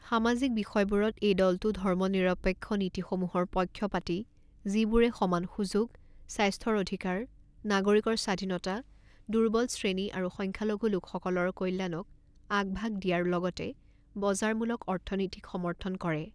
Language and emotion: Assamese, neutral